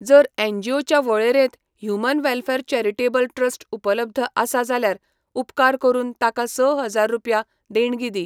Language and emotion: Goan Konkani, neutral